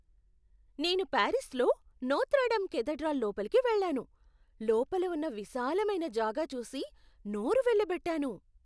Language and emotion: Telugu, surprised